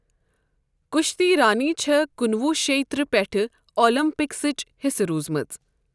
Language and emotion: Kashmiri, neutral